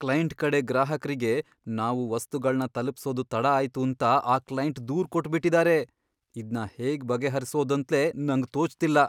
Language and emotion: Kannada, fearful